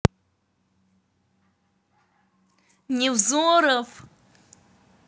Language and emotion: Russian, neutral